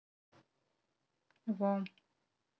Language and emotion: Russian, neutral